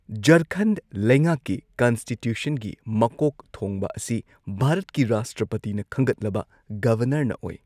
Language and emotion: Manipuri, neutral